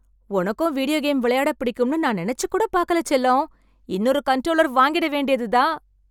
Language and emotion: Tamil, happy